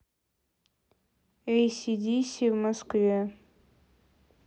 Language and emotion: Russian, neutral